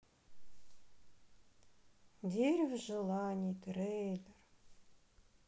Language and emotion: Russian, sad